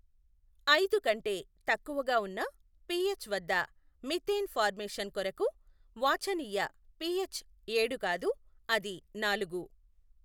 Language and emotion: Telugu, neutral